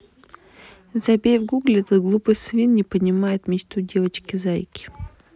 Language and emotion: Russian, neutral